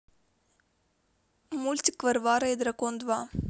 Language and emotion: Russian, neutral